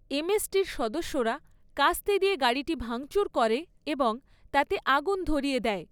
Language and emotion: Bengali, neutral